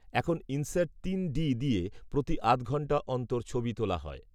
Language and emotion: Bengali, neutral